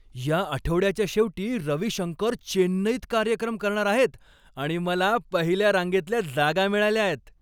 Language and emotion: Marathi, happy